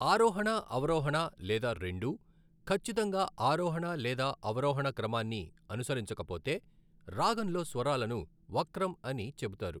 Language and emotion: Telugu, neutral